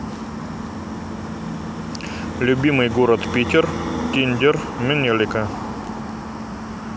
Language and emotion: Russian, neutral